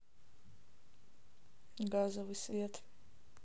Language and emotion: Russian, neutral